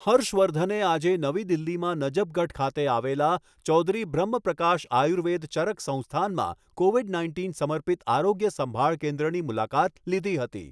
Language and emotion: Gujarati, neutral